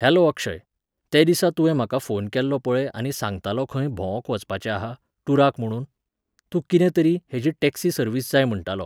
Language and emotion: Goan Konkani, neutral